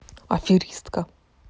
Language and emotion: Russian, neutral